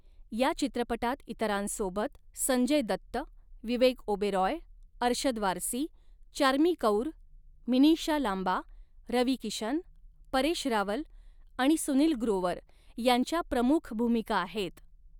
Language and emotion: Marathi, neutral